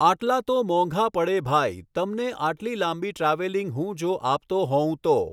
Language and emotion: Gujarati, neutral